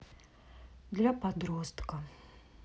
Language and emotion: Russian, neutral